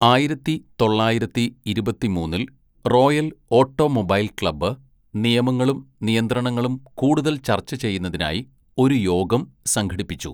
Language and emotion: Malayalam, neutral